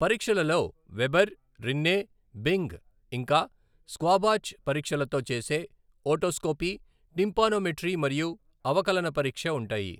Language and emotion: Telugu, neutral